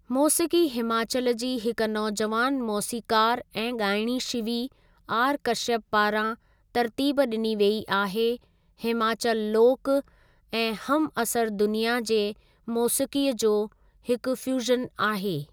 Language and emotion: Sindhi, neutral